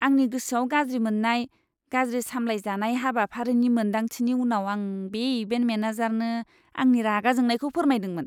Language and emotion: Bodo, disgusted